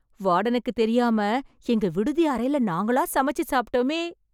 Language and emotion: Tamil, happy